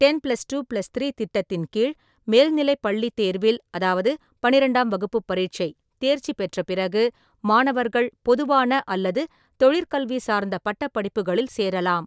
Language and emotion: Tamil, neutral